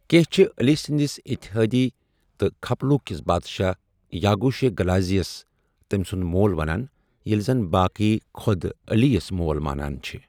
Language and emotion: Kashmiri, neutral